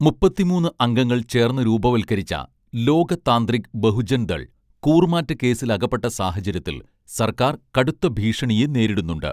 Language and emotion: Malayalam, neutral